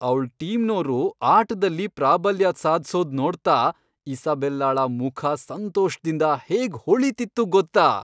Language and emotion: Kannada, happy